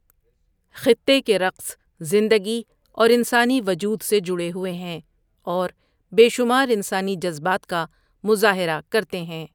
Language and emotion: Urdu, neutral